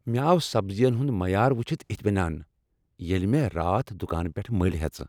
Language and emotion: Kashmiri, happy